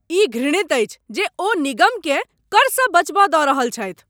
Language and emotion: Maithili, angry